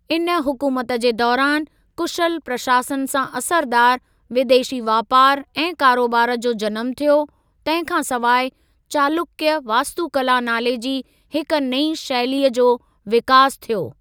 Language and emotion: Sindhi, neutral